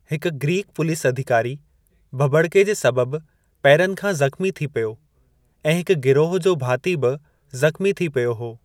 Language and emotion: Sindhi, neutral